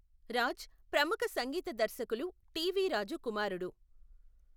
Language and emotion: Telugu, neutral